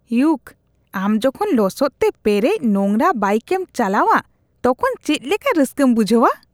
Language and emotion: Santali, disgusted